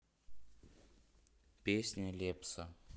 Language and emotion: Russian, neutral